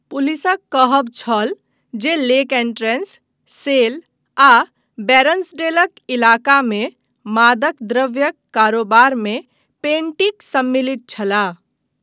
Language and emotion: Maithili, neutral